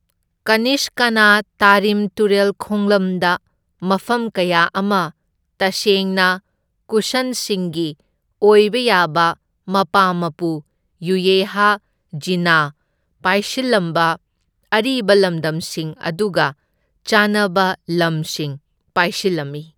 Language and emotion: Manipuri, neutral